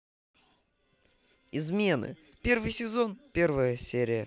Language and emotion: Russian, positive